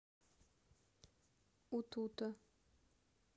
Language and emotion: Russian, neutral